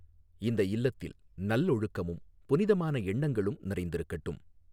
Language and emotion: Tamil, neutral